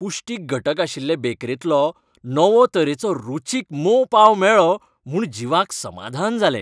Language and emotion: Goan Konkani, happy